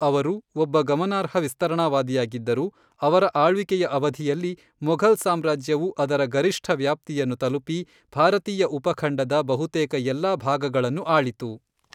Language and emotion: Kannada, neutral